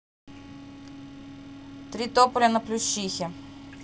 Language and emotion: Russian, neutral